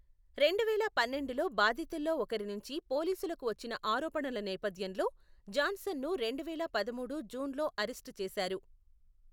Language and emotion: Telugu, neutral